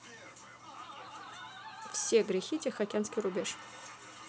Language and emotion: Russian, neutral